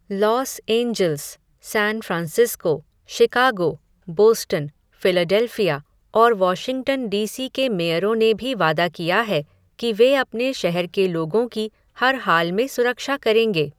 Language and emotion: Hindi, neutral